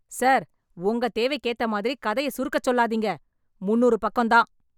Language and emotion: Tamil, angry